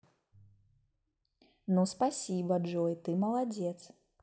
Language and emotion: Russian, positive